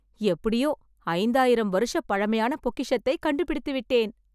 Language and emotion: Tamil, happy